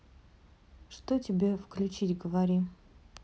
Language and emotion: Russian, neutral